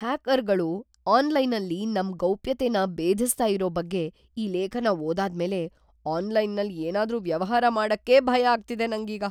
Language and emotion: Kannada, fearful